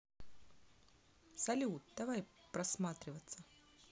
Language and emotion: Russian, positive